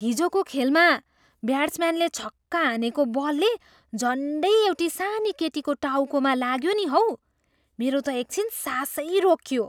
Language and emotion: Nepali, surprised